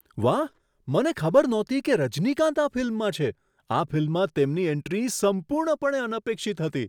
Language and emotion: Gujarati, surprised